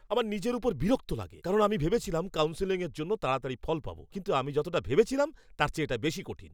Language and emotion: Bengali, angry